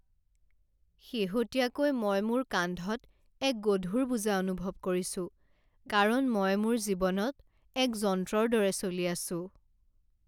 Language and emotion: Assamese, sad